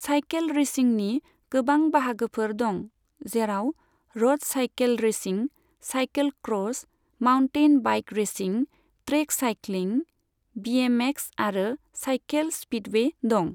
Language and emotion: Bodo, neutral